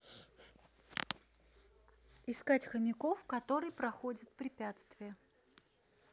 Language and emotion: Russian, neutral